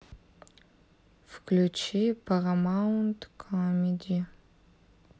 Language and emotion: Russian, sad